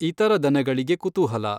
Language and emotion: Kannada, neutral